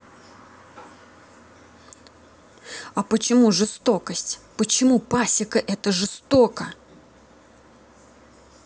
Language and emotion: Russian, angry